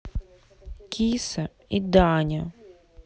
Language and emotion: Russian, neutral